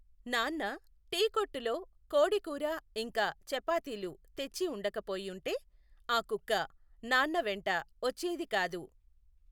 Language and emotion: Telugu, neutral